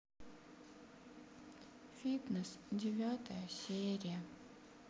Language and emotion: Russian, sad